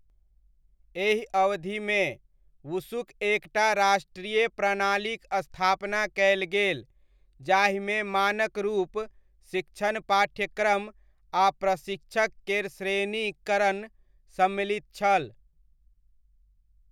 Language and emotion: Maithili, neutral